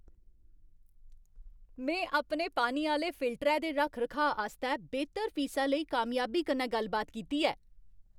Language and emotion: Dogri, happy